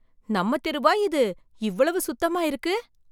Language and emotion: Tamil, surprised